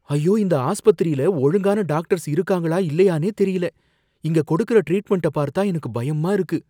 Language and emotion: Tamil, fearful